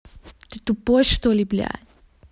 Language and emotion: Russian, angry